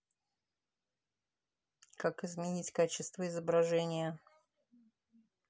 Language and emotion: Russian, neutral